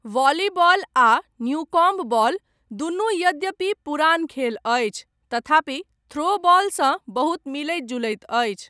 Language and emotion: Maithili, neutral